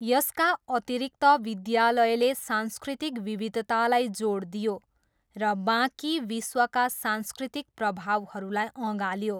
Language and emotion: Nepali, neutral